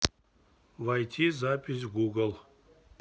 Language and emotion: Russian, neutral